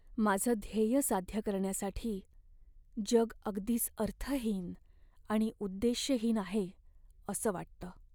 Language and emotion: Marathi, sad